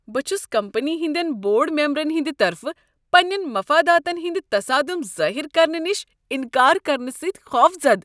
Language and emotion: Kashmiri, disgusted